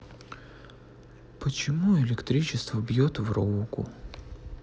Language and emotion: Russian, sad